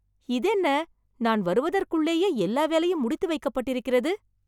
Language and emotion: Tamil, surprised